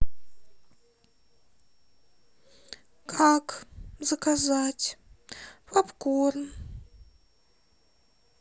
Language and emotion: Russian, sad